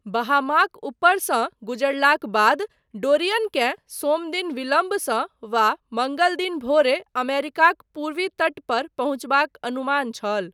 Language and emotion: Maithili, neutral